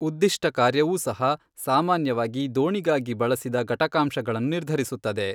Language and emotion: Kannada, neutral